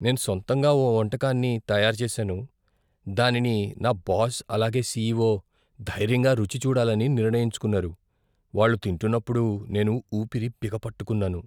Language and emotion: Telugu, fearful